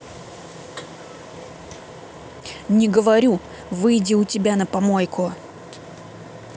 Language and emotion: Russian, angry